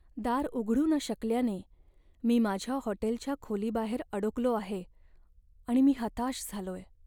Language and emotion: Marathi, sad